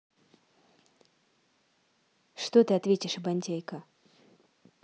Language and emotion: Russian, neutral